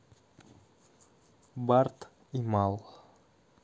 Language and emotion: Russian, neutral